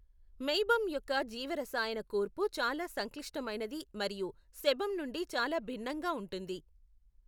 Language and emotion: Telugu, neutral